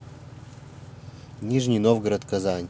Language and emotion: Russian, neutral